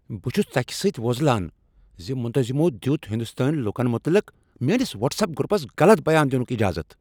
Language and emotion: Kashmiri, angry